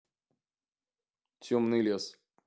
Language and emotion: Russian, neutral